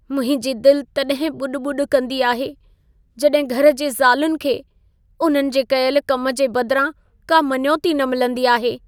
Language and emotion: Sindhi, sad